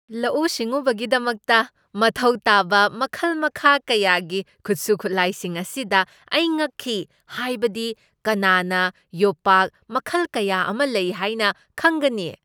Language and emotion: Manipuri, surprised